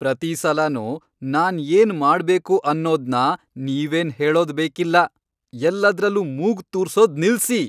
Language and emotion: Kannada, angry